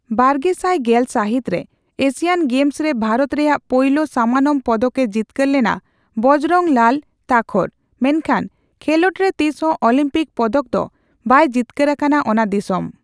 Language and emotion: Santali, neutral